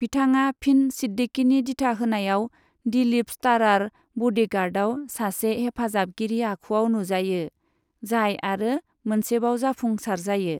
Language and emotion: Bodo, neutral